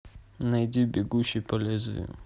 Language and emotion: Russian, neutral